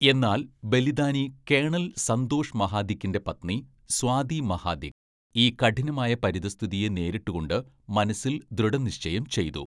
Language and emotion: Malayalam, neutral